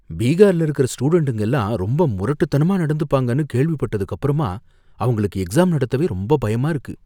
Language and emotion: Tamil, fearful